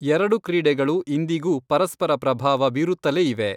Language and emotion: Kannada, neutral